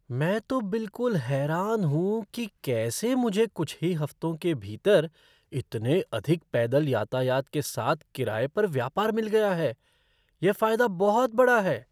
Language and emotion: Hindi, surprised